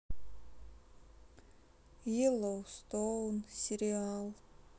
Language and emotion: Russian, sad